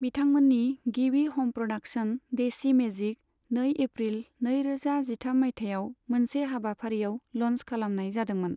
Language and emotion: Bodo, neutral